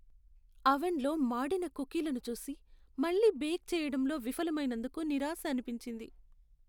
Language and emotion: Telugu, sad